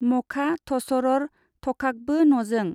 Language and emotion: Bodo, neutral